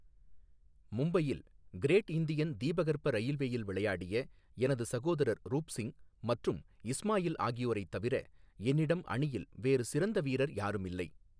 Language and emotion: Tamil, neutral